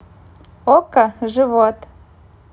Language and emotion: Russian, positive